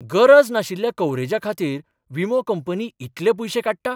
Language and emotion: Goan Konkani, surprised